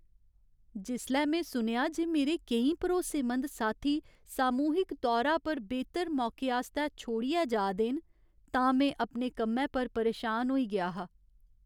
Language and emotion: Dogri, sad